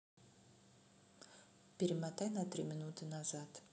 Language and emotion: Russian, neutral